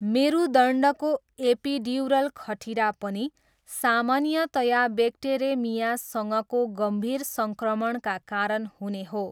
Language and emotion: Nepali, neutral